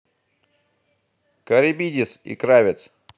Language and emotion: Russian, positive